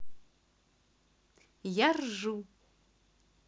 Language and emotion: Russian, positive